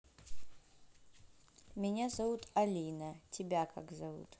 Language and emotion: Russian, neutral